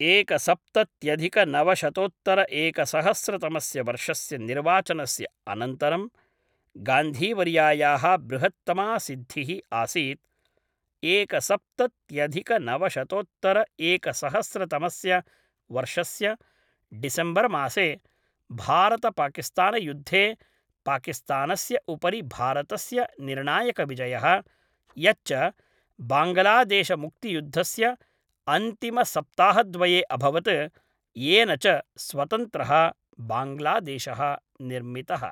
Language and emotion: Sanskrit, neutral